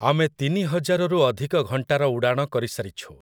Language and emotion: Odia, neutral